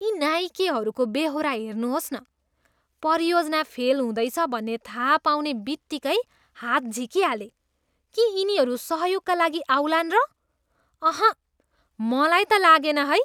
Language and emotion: Nepali, disgusted